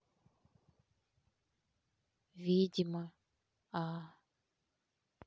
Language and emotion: Russian, neutral